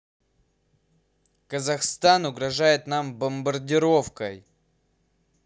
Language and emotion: Russian, neutral